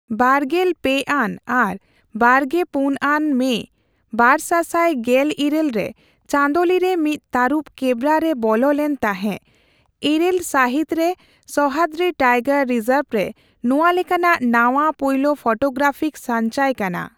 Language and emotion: Santali, neutral